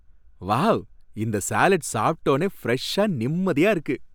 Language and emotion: Tamil, happy